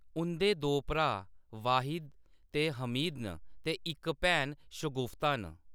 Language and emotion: Dogri, neutral